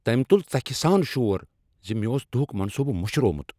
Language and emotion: Kashmiri, angry